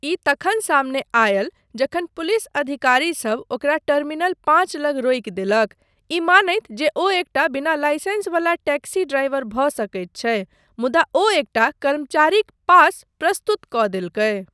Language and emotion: Maithili, neutral